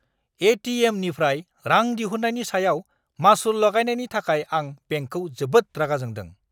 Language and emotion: Bodo, angry